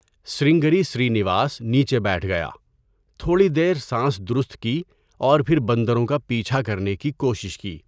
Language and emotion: Urdu, neutral